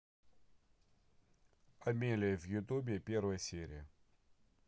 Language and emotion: Russian, neutral